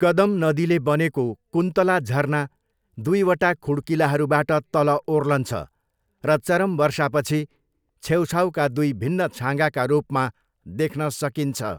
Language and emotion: Nepali, neutral